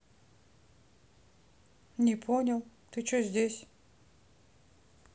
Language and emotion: Russian, neutral